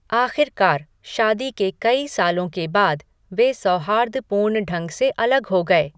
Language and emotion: Hindi, neutral